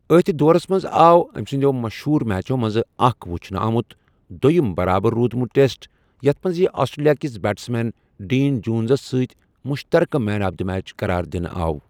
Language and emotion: Kashmiri, neutral